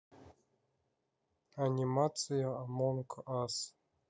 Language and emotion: Russian, neutral